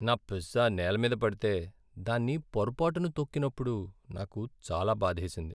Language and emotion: Telugu, sad